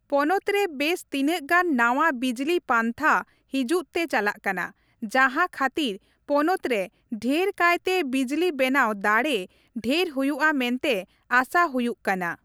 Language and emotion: Santali, neutral